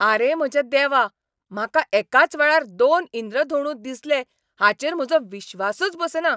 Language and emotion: Goan Konkani, angry